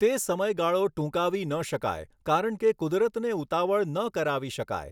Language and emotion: Gujarati, neutral